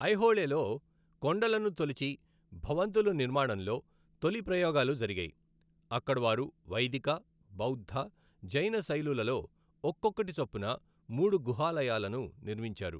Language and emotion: Telugu, neutral